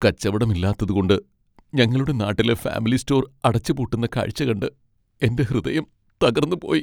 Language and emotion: Malayalam, sad